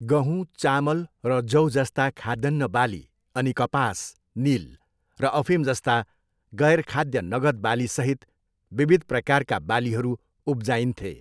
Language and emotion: Nepali, neutral